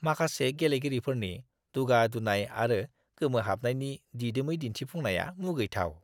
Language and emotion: Bodo, disgusted